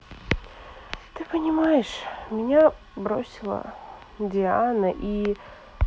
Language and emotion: Russian, sad